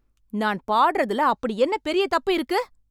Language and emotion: Tamil, angry